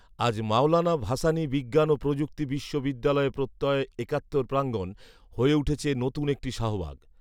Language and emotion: Bengali, neutral